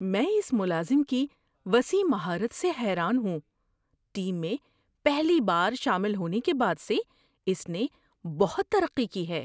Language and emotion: Urdu, surprised